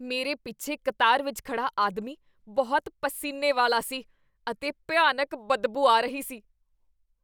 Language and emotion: Punjabi, disgusted